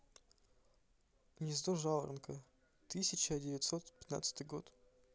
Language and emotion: Russian, neutral